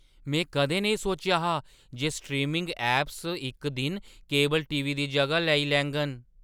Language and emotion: Dogri, surprised